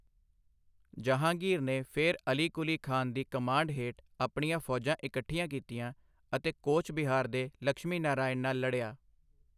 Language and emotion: Punjabi, neutral